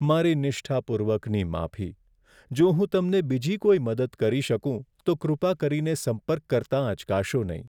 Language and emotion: Gujarati, sad